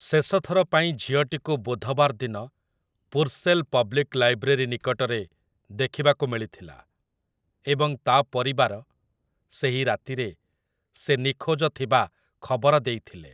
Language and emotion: Odia, neutral